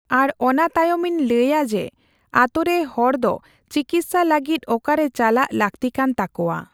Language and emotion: Santali, neutral